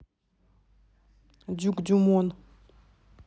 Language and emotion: Russian, neutral